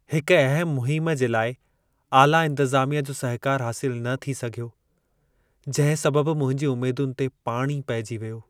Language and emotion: Sindhi, sad